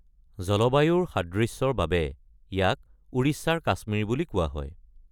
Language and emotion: Assamese, neutral